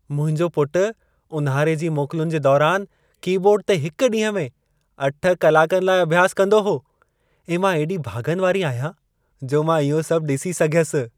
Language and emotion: Sindhi, happy